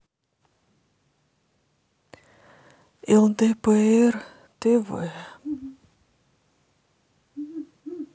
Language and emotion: Russian, sad